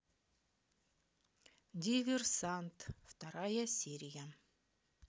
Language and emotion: Russian, neutral